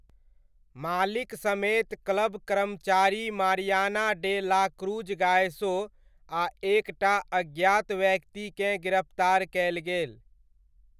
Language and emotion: Maithili, neutral